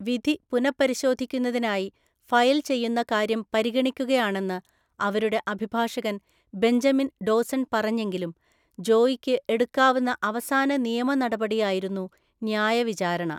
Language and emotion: Malayalam, neutral